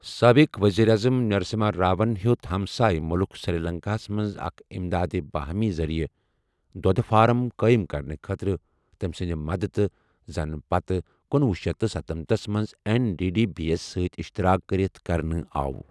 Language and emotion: Kashmiri, neutral